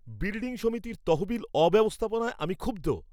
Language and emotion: Bengali, angry